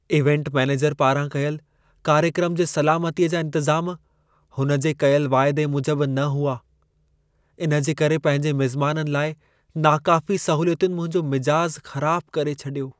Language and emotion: Sindhi, sad